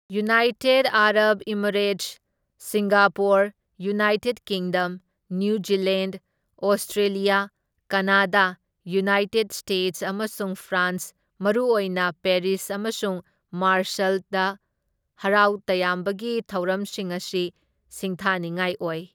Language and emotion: Manipuri, neutral